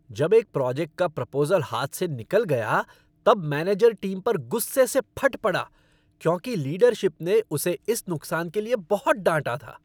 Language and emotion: Hindi, angry